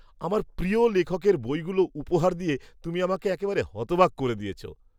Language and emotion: Bengali, surprised